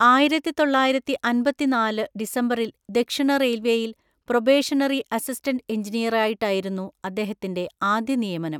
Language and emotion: Malayalam, neutral